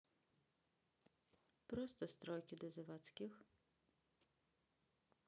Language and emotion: Russian, sad